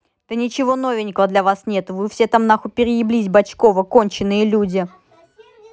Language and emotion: Russian, angry